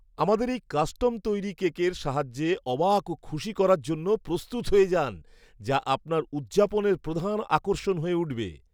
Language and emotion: Bengali, surprised